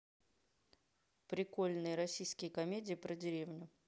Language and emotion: Russian, neutral